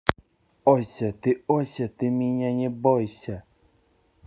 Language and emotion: Russian, neutral